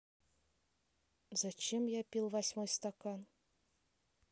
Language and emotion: Russian, neutral